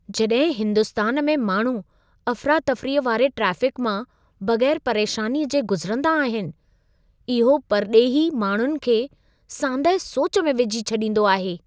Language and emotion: Sindhi, surprised